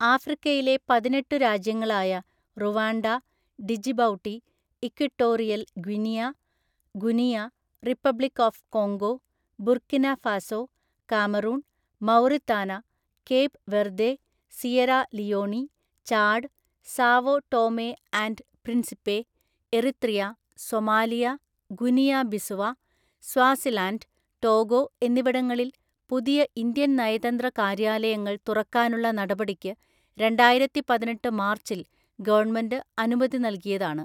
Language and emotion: Malayalam, neutral